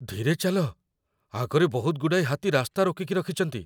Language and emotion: Odia, fearful